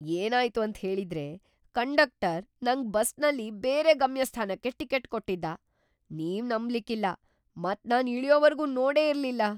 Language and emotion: Kannada, surprised